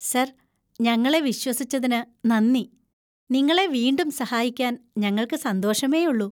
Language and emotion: Malayalam, happy